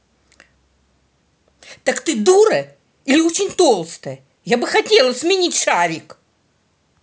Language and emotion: Russian, angry